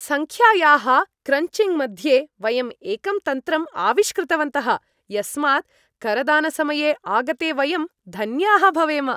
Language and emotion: Sanskrit, happy